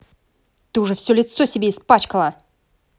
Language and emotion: Russian, angry